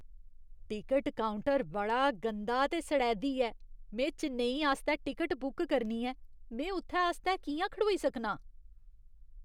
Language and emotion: Dogri, disgusted